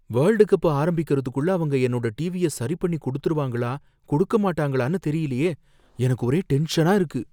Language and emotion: Tamil, fearful